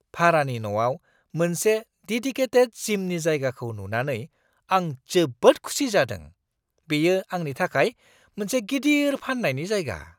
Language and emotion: Bodo, surprised